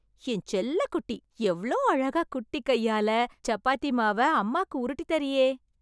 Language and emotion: Tamil, happy